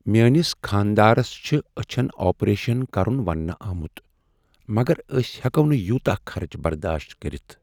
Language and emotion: Kashmiri, sad